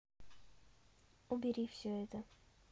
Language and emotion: Russian, neutral